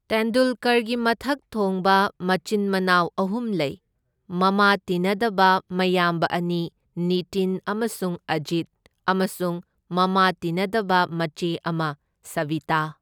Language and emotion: Manipuri, neutral